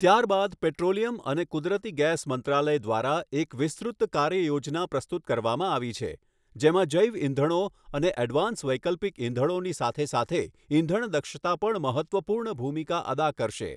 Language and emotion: Gujarati, neutral